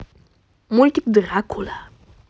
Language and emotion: Russian, positive